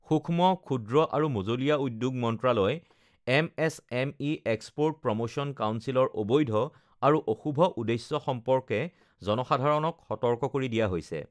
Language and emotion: Assamese, neutral